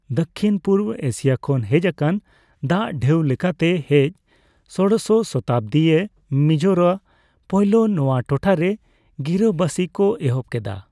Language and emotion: Santali, neutral